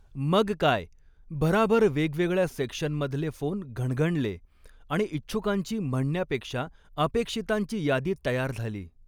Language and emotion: Marathi, neutral